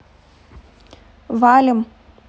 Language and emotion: Russian, neutral